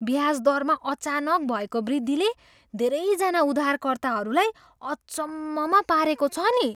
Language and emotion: Nepali, surprised